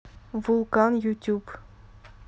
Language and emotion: Russian, neutral